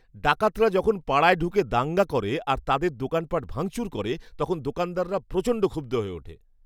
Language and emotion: Bengali, angry